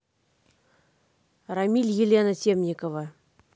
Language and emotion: Russian, neutral